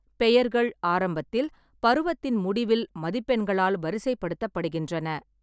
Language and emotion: Tamil, neutral